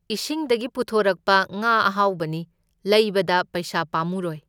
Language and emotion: Manipuri, neutral